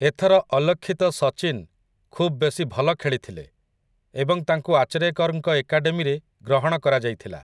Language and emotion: Odia, neutral